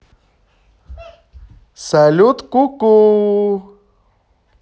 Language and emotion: Russian, positive